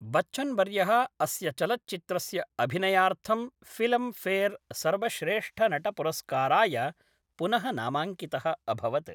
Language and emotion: Sanskrit, neutral